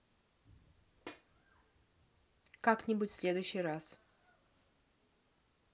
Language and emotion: Russian, neutral